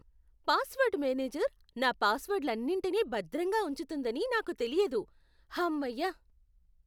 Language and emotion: Telugu, surprised